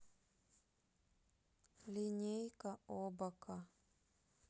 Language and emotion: Russian, neutral